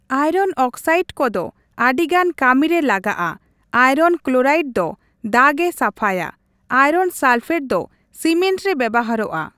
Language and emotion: Santali, neutral